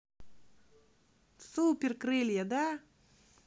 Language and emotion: Russian, positive